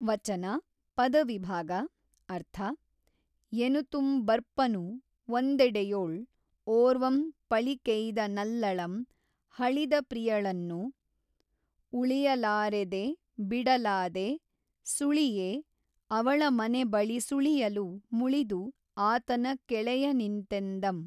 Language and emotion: Kannada, neutral